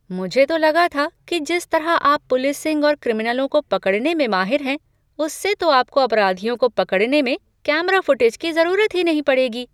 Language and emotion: Hindi, surprised